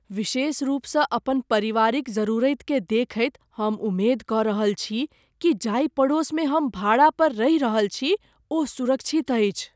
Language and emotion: Maithili, fearful